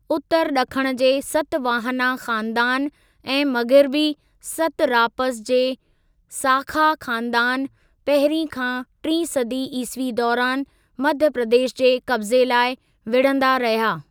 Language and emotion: Sindhi, neutral